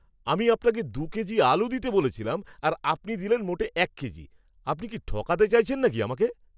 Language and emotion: Bengali, angry